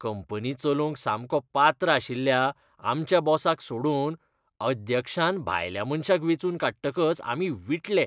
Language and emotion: Goan Konkani, disgusted